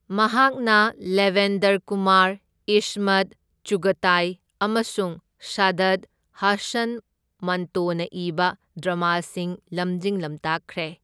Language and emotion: Manipuri, neutral